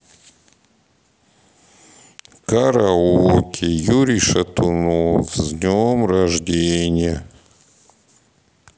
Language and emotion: Russian, sad